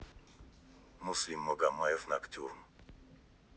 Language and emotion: Russian, neutral